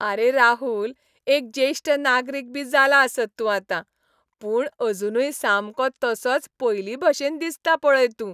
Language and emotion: Goan Konkani, happy